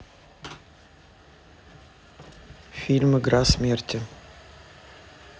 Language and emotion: Russian, neutral